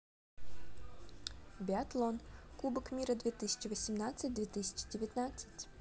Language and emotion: Russian, positive